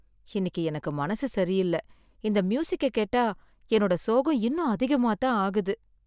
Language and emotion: Tamil, sad